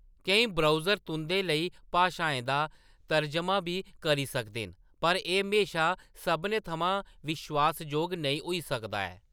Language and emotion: Dogri, neutral